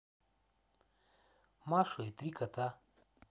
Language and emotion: Russian, neutral